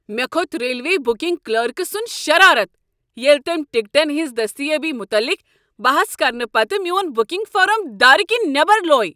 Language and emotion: Kashmiri, angry